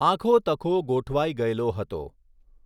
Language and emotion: Gujarati, neutral